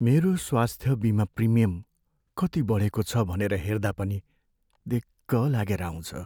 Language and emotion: Nepali, sad